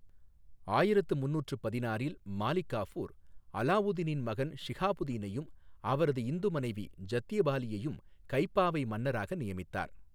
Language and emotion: Tamil, neutral